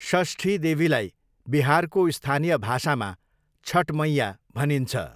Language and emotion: Nepali, neutral